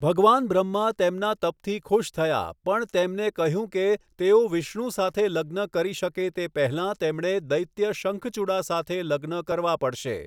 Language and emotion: Gujarati, neutral